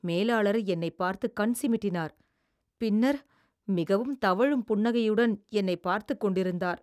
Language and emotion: Tamil, disgusted